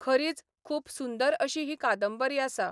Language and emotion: Goan Konkani, neutral